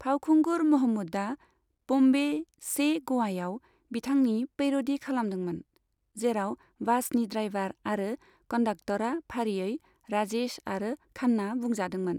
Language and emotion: Bodo, neutral